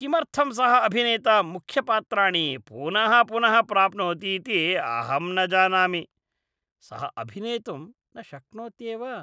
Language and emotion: Sanskrit, disgusted